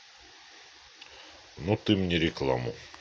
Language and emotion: Russian, neutral